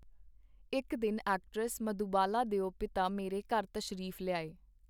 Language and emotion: Punjabi, neutral